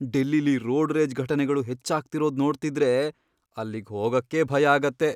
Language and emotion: Kannada, fearful